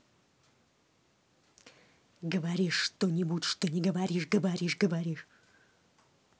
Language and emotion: Russian, angry